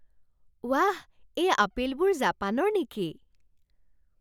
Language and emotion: Assamese, surprised